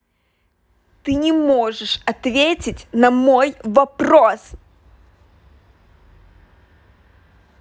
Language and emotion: Russian, angry